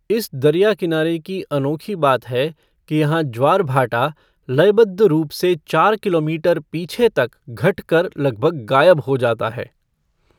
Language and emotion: Hindi, neutral